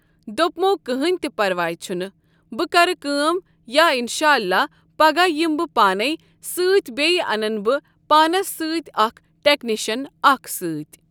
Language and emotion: Kashmiri, neutral